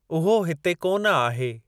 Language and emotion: Sindhi, neutral